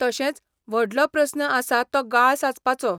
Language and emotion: Goan Konkani, neutral